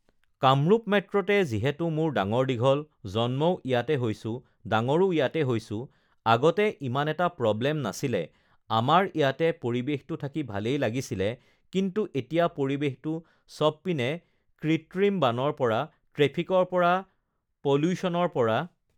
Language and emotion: Assamese, neutral